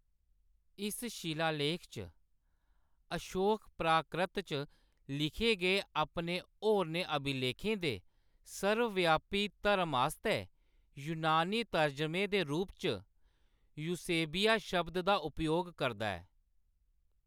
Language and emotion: Dogri, neutral